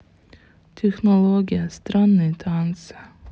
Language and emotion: Russian, sad